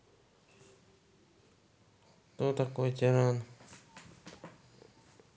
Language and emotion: Russian, neutral